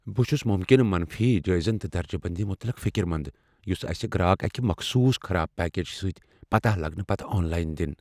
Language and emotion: Kashmiri, fearful